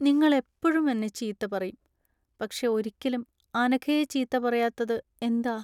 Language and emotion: Malayalam, sad